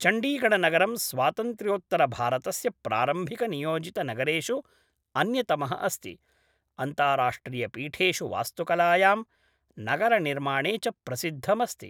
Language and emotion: Sanskrit, neutral